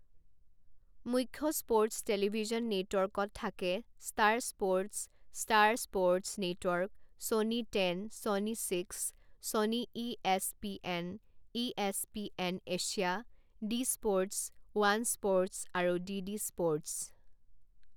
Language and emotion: Assamese, neutral